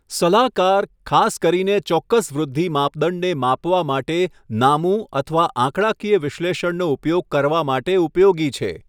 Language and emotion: Gujarati, neutral